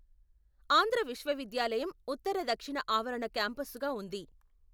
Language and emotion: Telugu, neutral